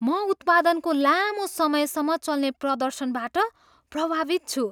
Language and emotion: Nepali, surprised